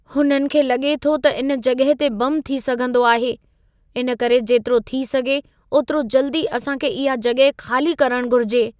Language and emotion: Sindhi, fearful